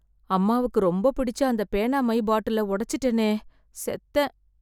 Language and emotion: Tamil, fearful